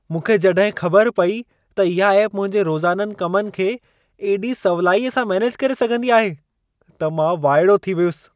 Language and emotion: Sindhi, surprised